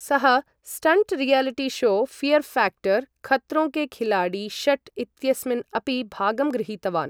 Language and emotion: Sanskrit, neutral